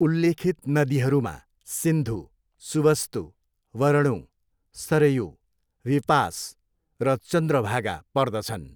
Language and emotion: Nepali, neutral